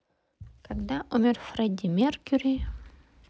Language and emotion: Russian, neutral